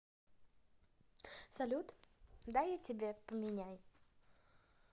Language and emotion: Russian, positive